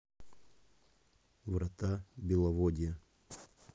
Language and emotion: Russian, neutral